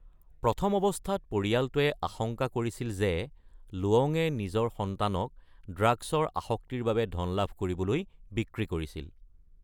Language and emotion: Assamese, neutral